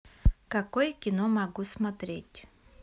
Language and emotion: Russian, neutral